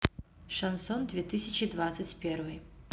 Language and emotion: Russian, neutral